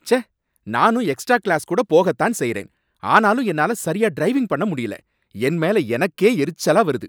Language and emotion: Tamil, angry